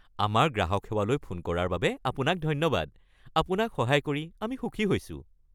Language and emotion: Assamese, happy